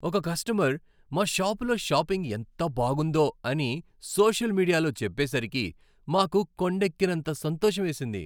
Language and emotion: Telugu, happy